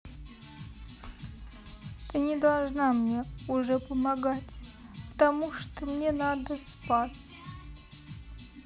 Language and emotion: Russian, sad